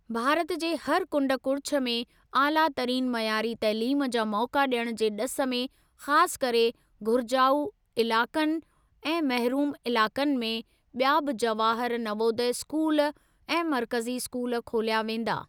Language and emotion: Sindhi, neutral